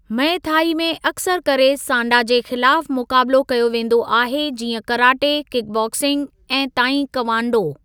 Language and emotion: Sindhi, neutral